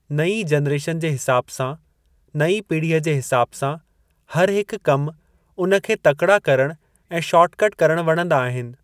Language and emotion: Sindhi, neutral